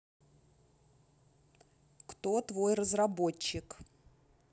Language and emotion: Russian, neutral